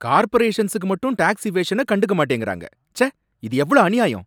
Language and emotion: Tamil, angry